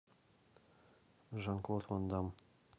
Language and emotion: Russian, neutral